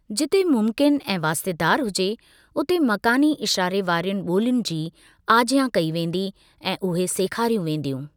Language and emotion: Sindhi, neutral